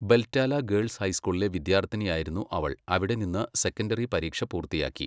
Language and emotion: Malayalam, neutral